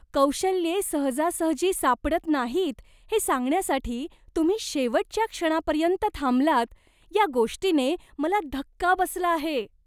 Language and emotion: Marathi, disgusted